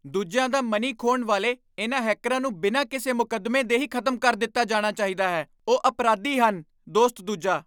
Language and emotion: Punjabi, angry